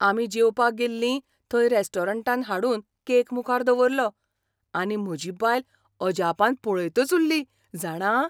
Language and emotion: Goan Konkani, surprised